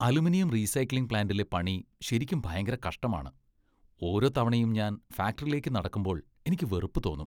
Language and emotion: Malayalam, disgusted